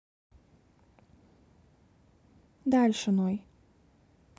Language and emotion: Russian, neutral